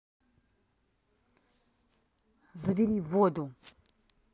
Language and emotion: Russian, angry